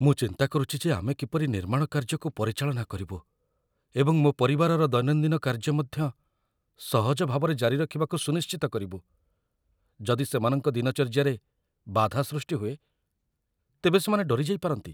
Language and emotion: Odia, fearful